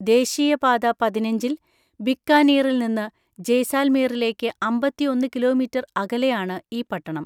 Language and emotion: Malayalam, neutral